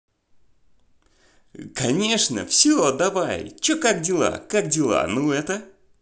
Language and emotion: Russian, positive